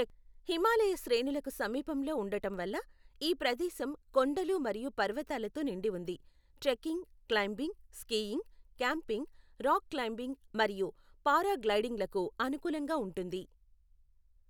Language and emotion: Telugu, neutral